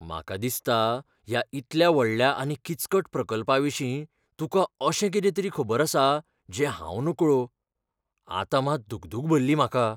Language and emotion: Goan Konkani, fearful